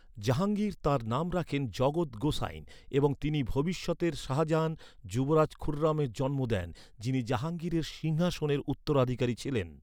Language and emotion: Bengali, neutral